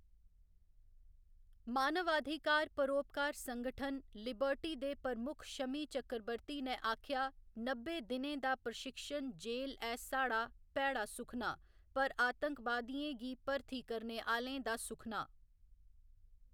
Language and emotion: Dogri, neutral